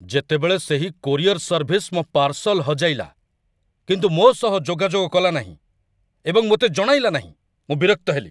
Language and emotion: Odia, angry